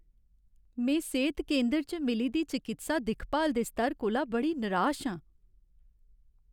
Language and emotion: Dogri, sad